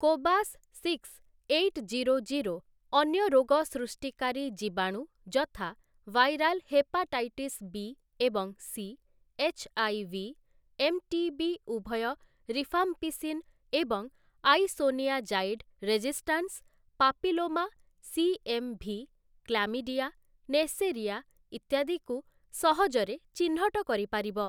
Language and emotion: Odia, neutral